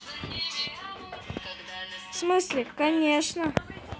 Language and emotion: Russian, neutral